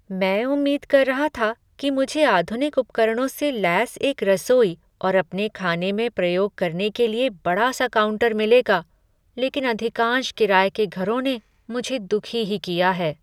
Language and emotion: Hindi, sad